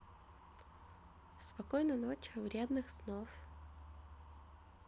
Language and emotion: Russian, neutral